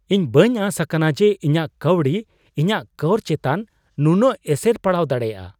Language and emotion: Santali, surprised